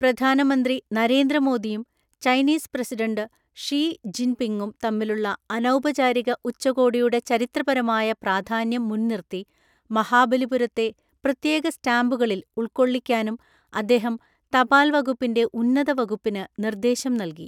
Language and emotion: Malayalam, neutral